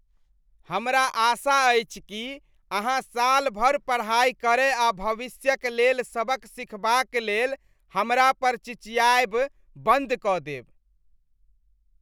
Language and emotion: Maithili, disgusted